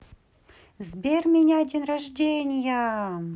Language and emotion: Russian, positive